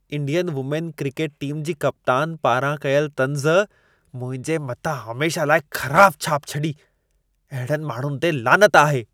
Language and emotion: Sindhi, disgusted